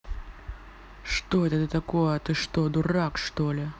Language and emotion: Russian, angry